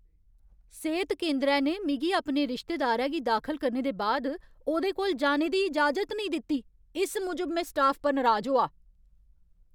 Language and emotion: Dogri, angry